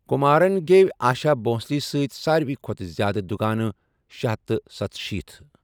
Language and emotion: Kashmiri, neutral